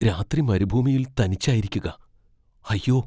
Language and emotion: Malayalam, fearful